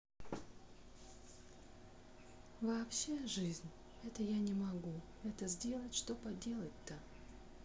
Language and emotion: Russian, sad